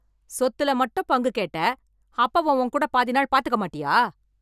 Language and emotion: Tamil, angry